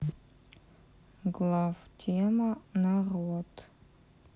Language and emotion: Russian, neutral